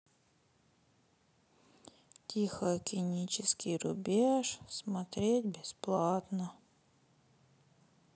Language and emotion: Russian, sad